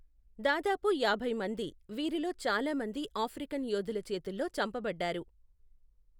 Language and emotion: Telugu, neutral